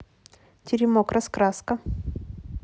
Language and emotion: Russian, neutral